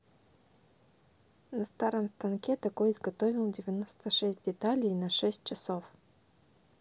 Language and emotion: Russian, neutral